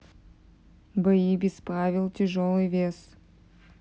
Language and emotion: Russian, neutral